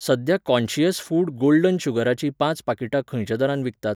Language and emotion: Goan Konkani, neutral